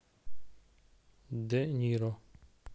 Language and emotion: Russian, neutral